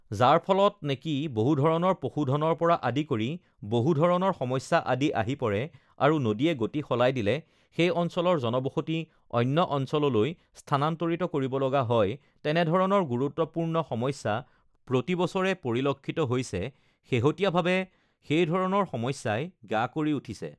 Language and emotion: Assamese, neutral